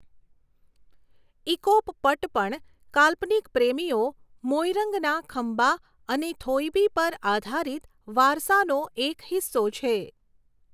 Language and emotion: Gujarati, neutral